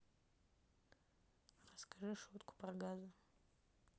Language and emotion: Russian, neutral